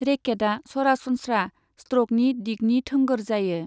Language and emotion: Bodo, neutral